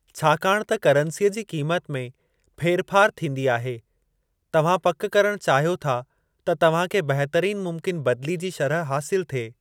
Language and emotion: Sindhi, neutral